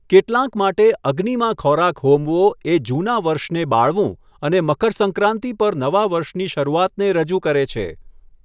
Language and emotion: Gujarati, neutral